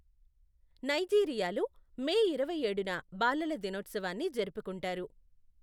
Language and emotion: Telugu, neutral